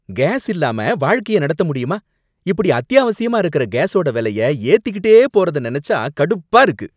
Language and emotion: Tamil, angry